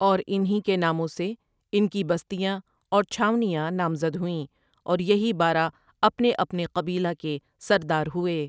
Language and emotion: Urdu, neutral